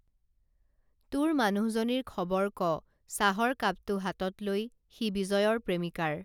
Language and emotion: Assamese, neutral